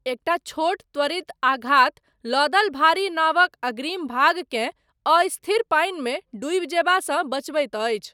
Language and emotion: Maithili, neutral